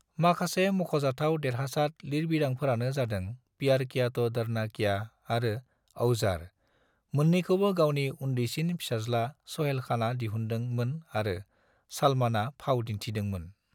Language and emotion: Bodo, neutral